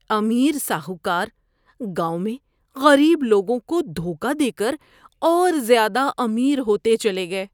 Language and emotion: Urdu, disgusted